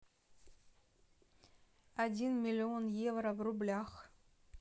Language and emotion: Russian, neutral